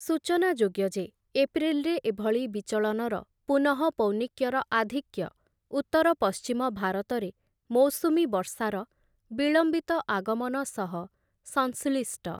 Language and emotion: Odia, neutral